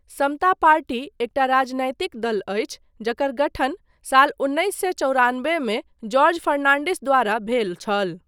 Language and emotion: Maithili, neutral